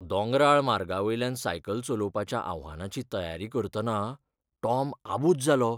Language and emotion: Goan Konkani, fearful